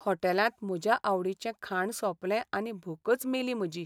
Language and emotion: Goan Konkani, sad